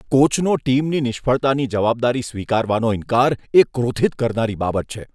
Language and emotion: Gujarati, disgusted